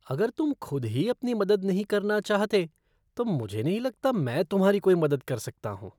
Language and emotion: Hindi, disgusted